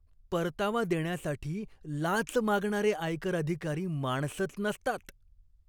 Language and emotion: Marathi, disgusted